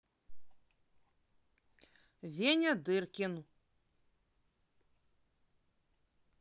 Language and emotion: Russian, positive